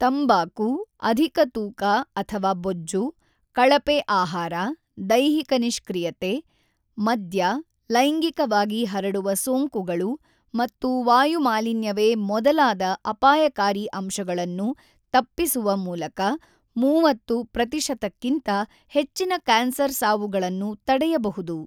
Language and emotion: Kannada, neutral